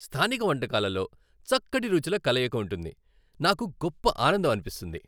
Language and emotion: Telugu, happy